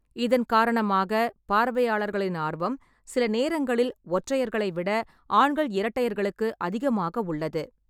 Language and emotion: Tamil, neutral